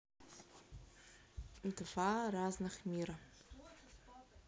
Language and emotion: Russian, neutral